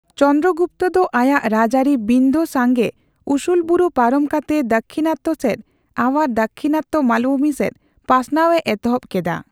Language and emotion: Santali, neutral